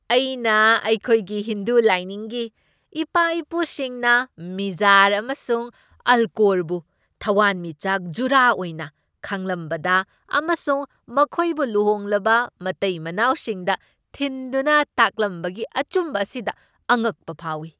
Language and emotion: Manipuri, surprised